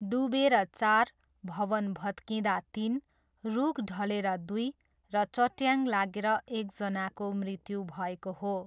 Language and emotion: Nepali, neutral